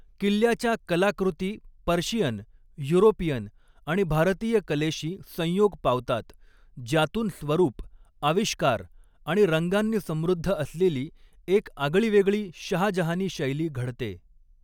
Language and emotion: Marathi, neutral